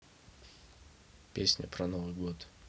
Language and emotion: Russian, neutral